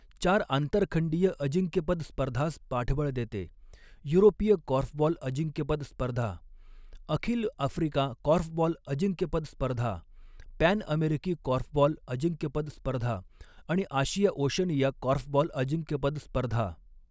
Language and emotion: Marathi, neutral